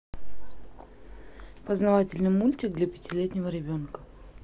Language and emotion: Russian, neutral